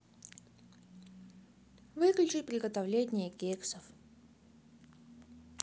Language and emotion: Russian, neutral